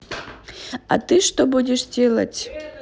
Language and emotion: Russian, neutral